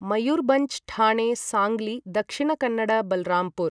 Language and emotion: Sanskrit, neutral